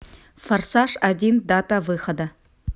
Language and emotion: Russian, neutral